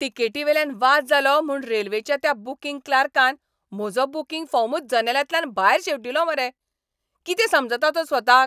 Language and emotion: Goan Konkani, angry